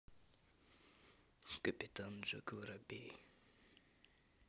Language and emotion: Russian, neutral